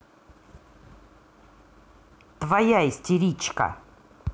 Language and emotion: Russian, angry